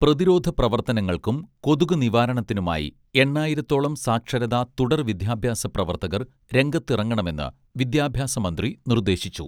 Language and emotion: Malayalam, neutral